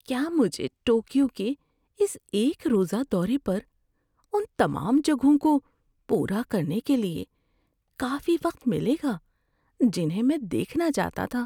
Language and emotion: Urdu, fearful